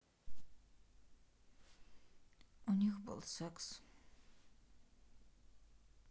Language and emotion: Russian, sad